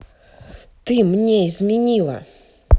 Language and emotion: Russian, angry